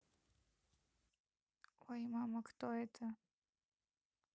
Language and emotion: Russian, neutral